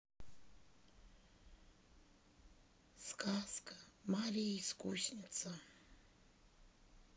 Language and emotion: Russian, sad